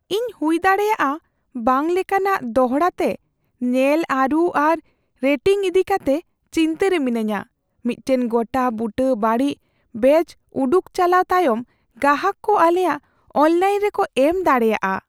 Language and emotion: Santali, fearful